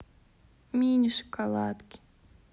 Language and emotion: Russian, sad